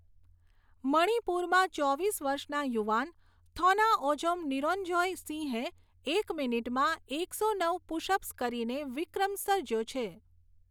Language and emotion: Gujarati, neutral